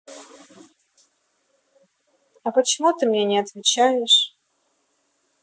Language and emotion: Russian, neutral